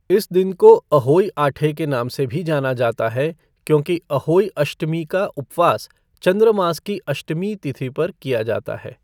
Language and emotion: Hindi, neutral